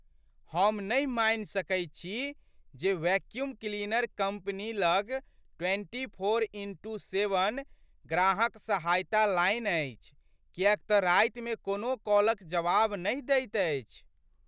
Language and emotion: Maithili, surprised